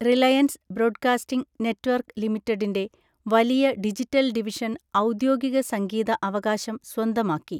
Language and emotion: Malayalam, neutral